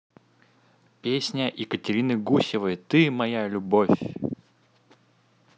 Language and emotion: Russian, positive